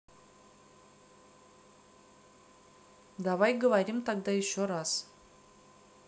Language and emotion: Russian, neutral